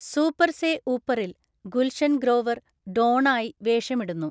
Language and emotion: Malayalam, neutral